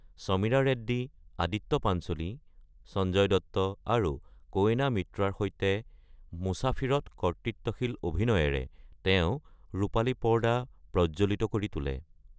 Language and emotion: Assamese, neutral